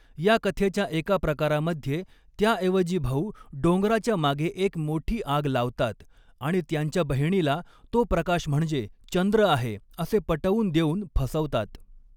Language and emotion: Marathi, neutral